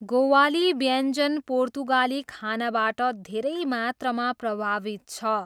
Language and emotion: Nepali, neutral